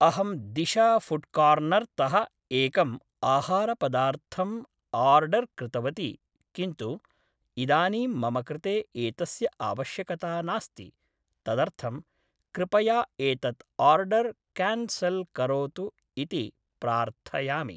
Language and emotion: Sanskrit, neutral